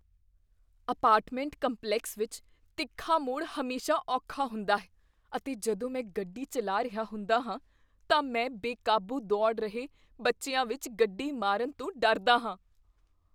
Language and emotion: Punjabi, fearful